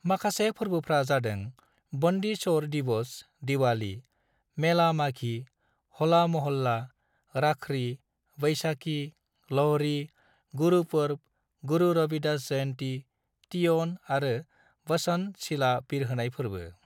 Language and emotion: Bodo, neutral